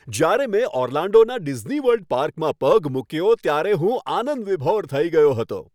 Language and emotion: Gujarati, happy